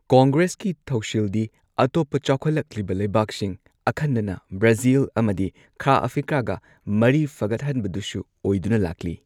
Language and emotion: Manipuri, neutral